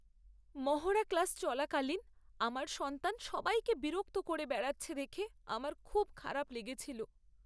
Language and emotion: Bengali, sad